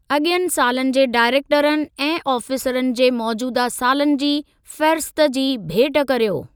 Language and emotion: Sindhi, neutral